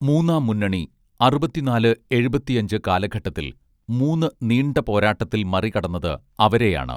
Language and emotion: Malayalam, neutral